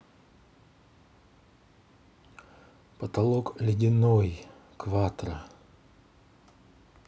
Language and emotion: Russian, neutral